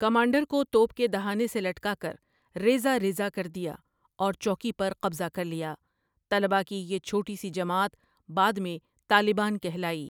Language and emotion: Urdu, neutral